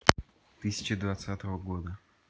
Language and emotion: Russian, neutral